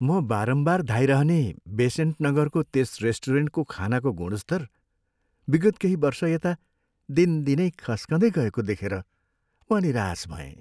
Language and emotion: Nepali, sad